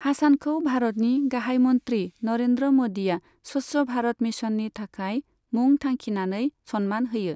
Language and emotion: Bodo, neutral